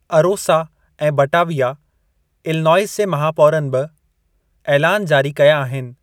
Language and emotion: Sindhi, neutral